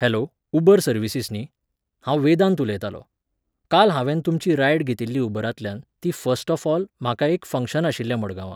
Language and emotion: Goan Konkani, neutral